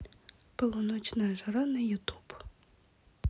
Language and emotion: Russian, neutral